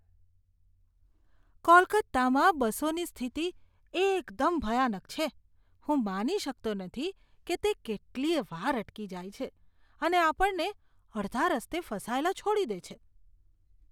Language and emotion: Gujarati, disgusted